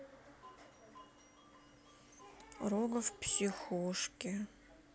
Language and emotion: Russian, sad